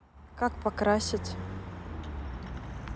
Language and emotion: Russian, neutral